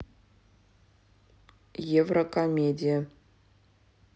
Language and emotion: Russian, neutral